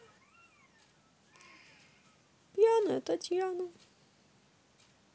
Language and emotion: Russian, neutral